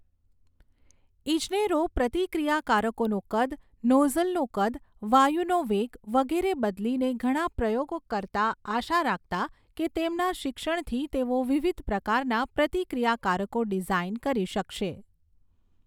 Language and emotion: Gujarati, neutral